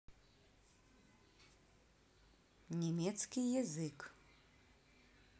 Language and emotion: Russian, neutral